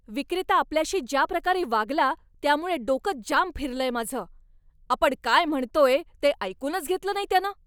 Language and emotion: Marathi, angry